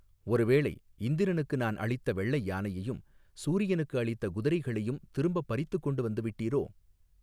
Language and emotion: Tamil, neutral